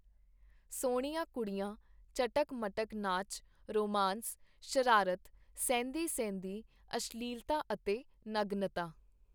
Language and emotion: Punjabi, neutral